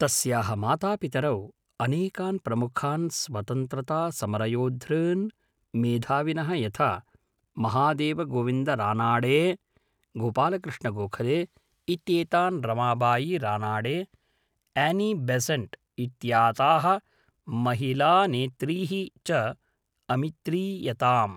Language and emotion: Sanskrit, neutral